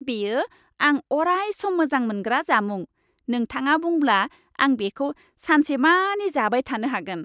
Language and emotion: Bodo, happy